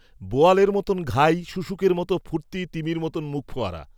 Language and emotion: Bengali, neutral